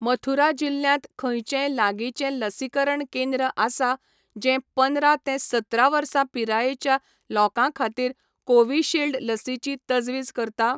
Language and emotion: Goan Konkani, neutral